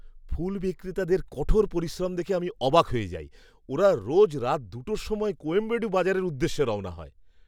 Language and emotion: Bengali, surprised